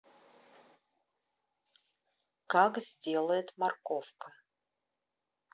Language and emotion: Russian, neutral